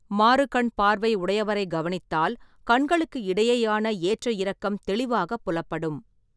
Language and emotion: Tamil, neutral